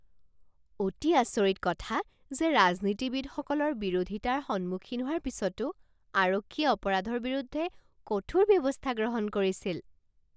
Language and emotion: Assamese, surprised